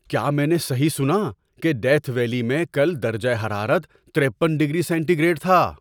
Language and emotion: Urdu, surprised